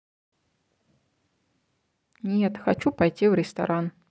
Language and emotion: Russian, neutral